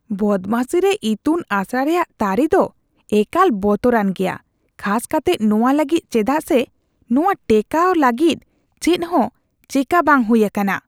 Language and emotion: Santali, disgusted